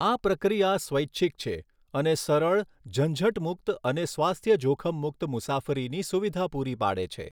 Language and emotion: Gujarati, neutral